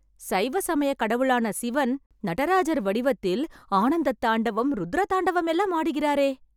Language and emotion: Tamil, happy